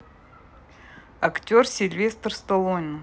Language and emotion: Russian, neutral